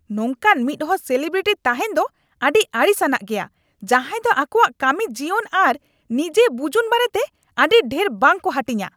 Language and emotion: Santali, angry